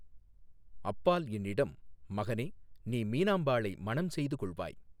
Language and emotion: Tamil, neutral